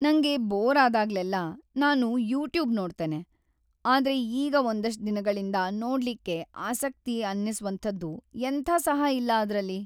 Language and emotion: Kannada, sad